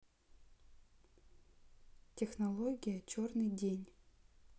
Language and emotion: Russian, neutral